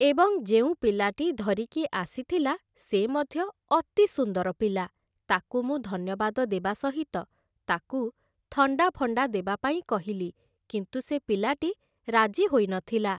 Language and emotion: Odia, neutral